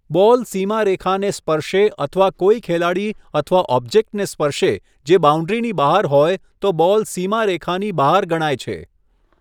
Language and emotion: Gujarati, neutral